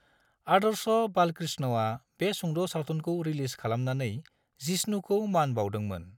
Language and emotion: Bodo, neutral